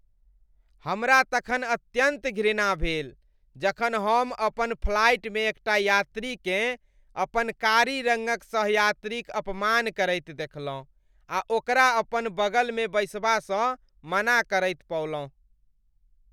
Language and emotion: Maithili, disgusted